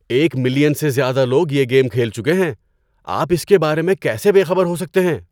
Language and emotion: Urdu, surprised